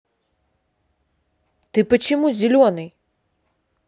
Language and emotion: Russian, angry